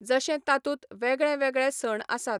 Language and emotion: Goan Konkani, neutral